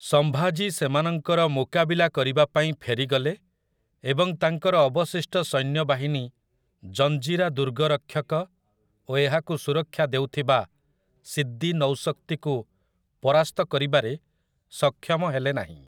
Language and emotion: Odia, neutral